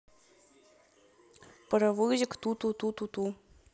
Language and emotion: Russian, neutral